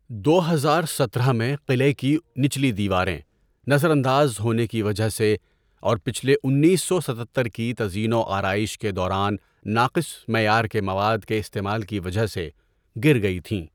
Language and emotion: Urdu, neutral